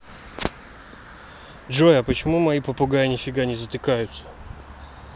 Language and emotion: Russian, neutral